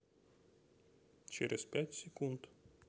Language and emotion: Russian, neutral